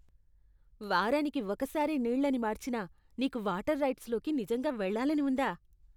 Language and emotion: Telugu, disgusted